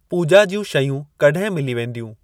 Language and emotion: Sindhi, neutral